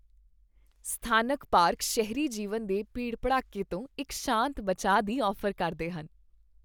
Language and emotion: Punjabi, happy